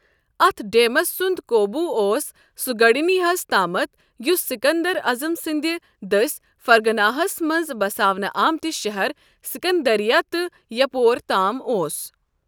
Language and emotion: Kashmiri, neutral